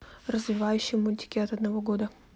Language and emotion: Russian, neutral